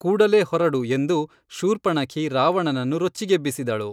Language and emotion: Kannada, neutral